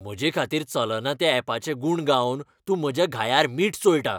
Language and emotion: Goan Konkani, angry